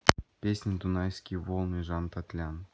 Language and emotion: Russian, neutral